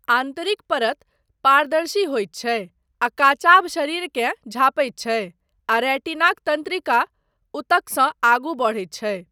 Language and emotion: Maithili, neutral